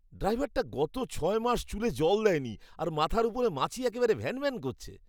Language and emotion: Bengali, disgusted